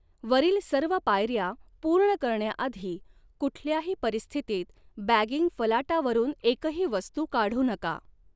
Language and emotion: Marathi, neutral